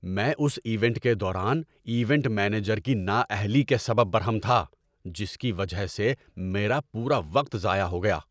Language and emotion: Urdu, angry